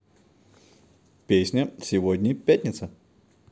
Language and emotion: Russian, positive